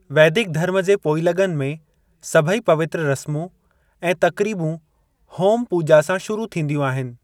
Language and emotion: Sindhi, neutral